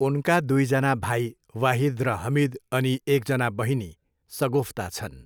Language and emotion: Nepali, neutral